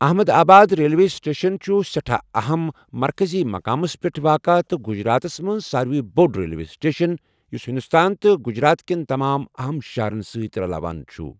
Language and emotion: Kashmiri, neutral